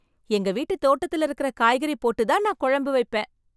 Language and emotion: Tamil, happy